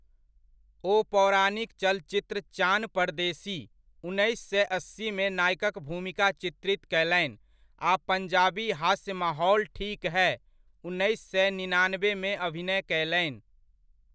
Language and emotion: Maithili, neutral